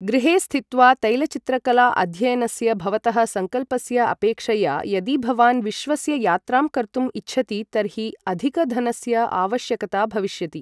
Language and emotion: Sanskrit, neutral